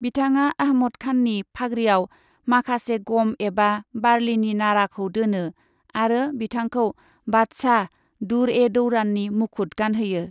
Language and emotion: Bodo, neutral